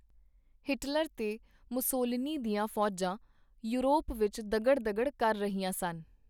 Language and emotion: Punjabi, neutral